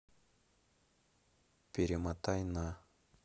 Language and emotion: Russian, neutral